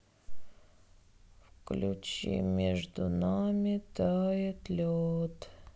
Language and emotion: Russian, sad